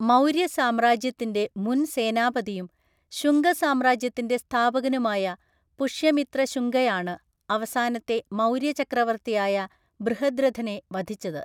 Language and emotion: Malayalam, neutral